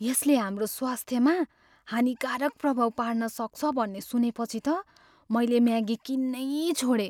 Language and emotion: Nepali, fearful